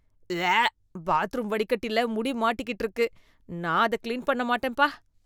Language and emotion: Tamil, disgusted